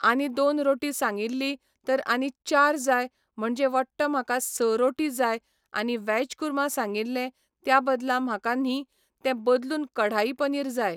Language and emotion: Goan Konkani, neutral